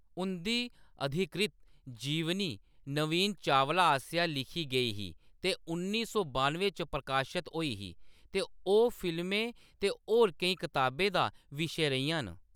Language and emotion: Dogri, neutral